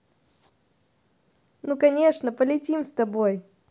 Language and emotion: Russian, positive